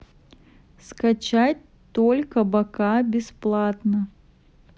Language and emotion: Russian, neutral